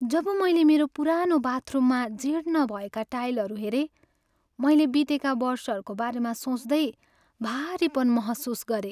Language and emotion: Nepali, sad